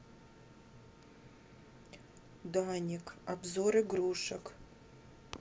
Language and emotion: Russian, neutral